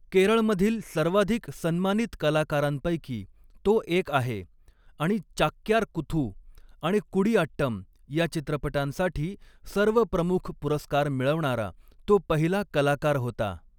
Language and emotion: Marathi, neutral